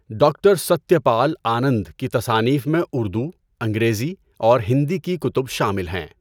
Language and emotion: Urdu, neutral